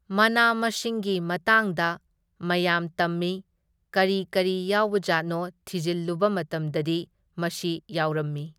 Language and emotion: Manipuri, neutral